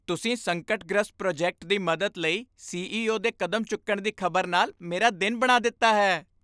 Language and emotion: Punjabi, happy